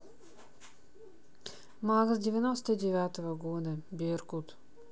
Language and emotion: Russian, neutral